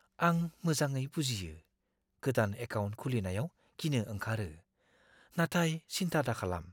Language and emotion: Bodo, fearful